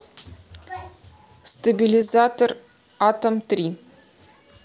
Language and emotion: Russian, neutral